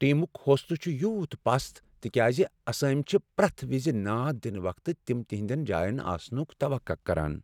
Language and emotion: Kashmiri, sad